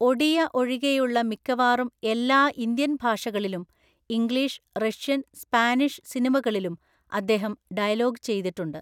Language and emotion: Malayalam, neutral